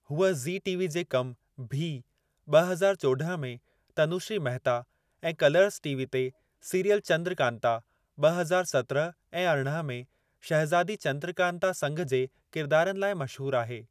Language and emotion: Sindhi, neutral